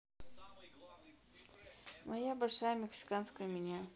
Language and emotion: Russian, neutral